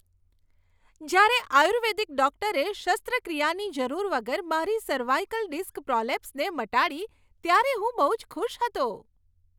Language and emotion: Gujarati, happy